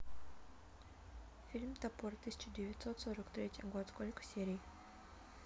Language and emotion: Russian, neutral